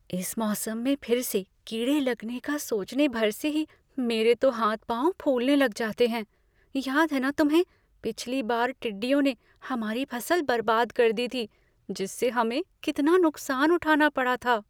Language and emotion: Hindi, fearful